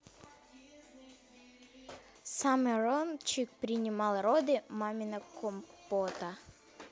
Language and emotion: Russian, neutral